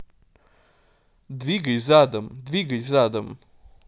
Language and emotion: Russian, neutral